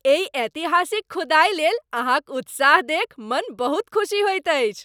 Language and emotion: Maithili, happy